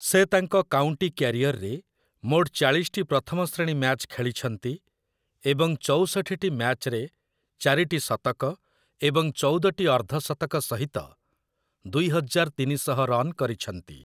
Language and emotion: Odia, neutral